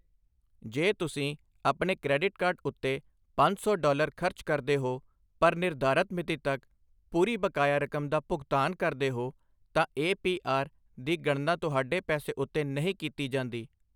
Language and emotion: Punjabi, neutral